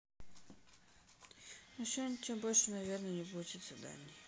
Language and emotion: Russian, sad